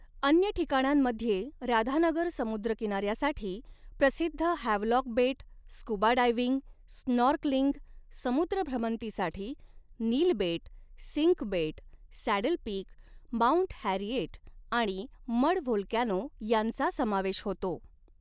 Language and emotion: Marathi, neutral